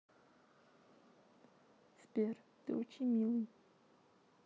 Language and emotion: Russian, sad